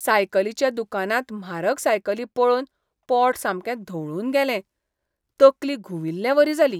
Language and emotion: Goan Konkani, disgusted